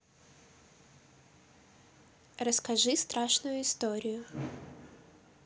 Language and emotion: Russian, neutral